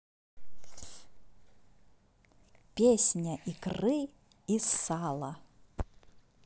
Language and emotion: Russian, positive